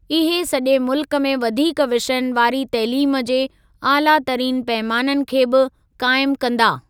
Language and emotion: Sindhi, neutral